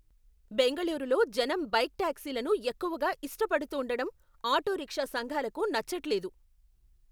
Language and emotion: Telugu, angry